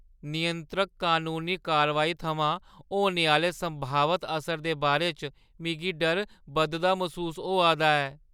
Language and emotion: Dogri, fearful